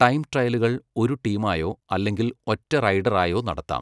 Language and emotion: Malayalam, neutral